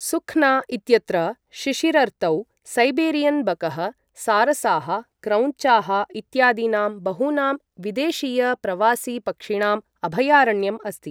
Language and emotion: Sanskrit, neutral